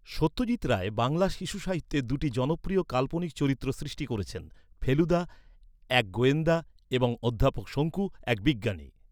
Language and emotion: Bengali, neutral